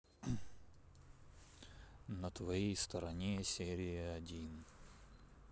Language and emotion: Russian, neutral